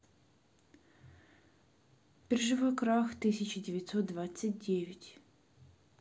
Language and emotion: Russian, neutral